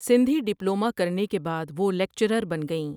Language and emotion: Urdu, neutral